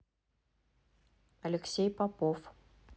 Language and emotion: Russian, neutral